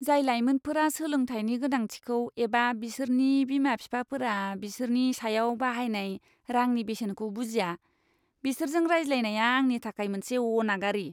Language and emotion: Bodo, disgusted